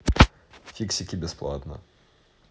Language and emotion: Russian, neutral